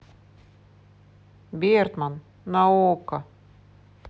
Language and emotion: Russian, neutral